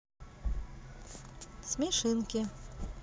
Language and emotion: Russian, neutral